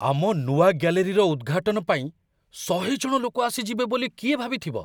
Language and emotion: Odia, surprised